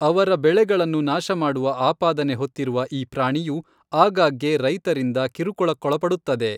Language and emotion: Kannada, neutral